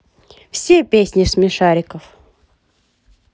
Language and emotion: Russian, positive